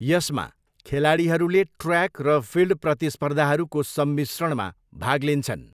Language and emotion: Nepali, neutral